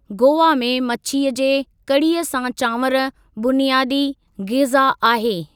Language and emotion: Sindhi, neutral